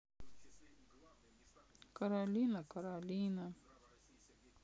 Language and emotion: Russian, sad